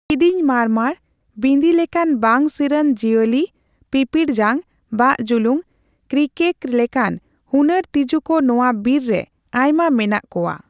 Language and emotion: Santali, neutral